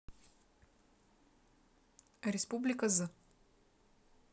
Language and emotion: Russian, neutral